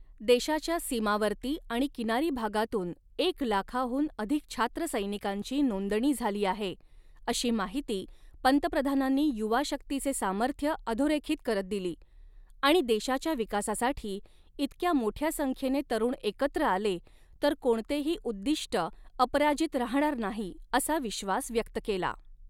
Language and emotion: Marathi, neutral